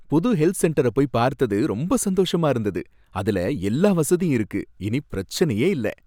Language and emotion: Tamil, happy